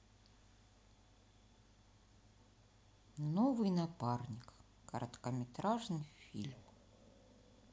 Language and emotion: Russian, sad